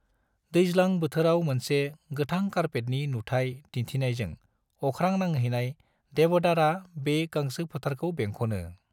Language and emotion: Bodo, neutral